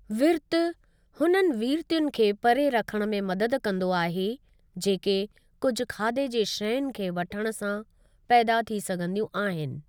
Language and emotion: Sindhi, neutral